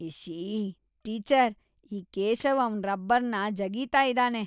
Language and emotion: Kannada, disgusted